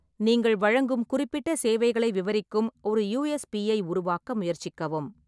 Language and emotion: Tamil, neutral